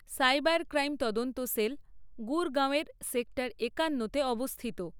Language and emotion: Bengali, neutral